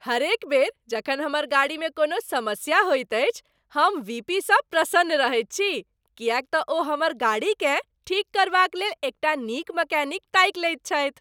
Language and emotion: Maithili, happy